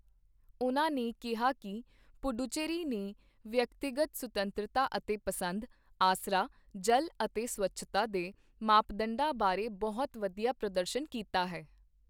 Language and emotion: Punjabi, neutral